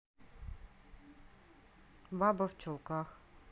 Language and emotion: Russian, neutral